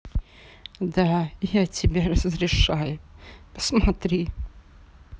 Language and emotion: Russian, sad